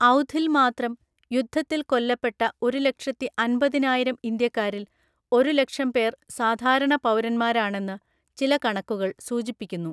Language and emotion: Malayalam, neutral